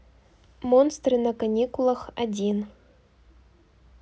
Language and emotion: Russian, neutral